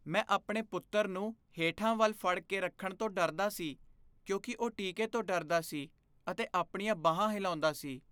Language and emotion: Punjabi, fearful